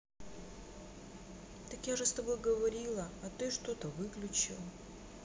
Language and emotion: Russian, sad